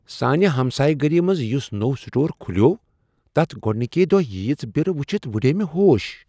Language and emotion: Kashmiri, surprised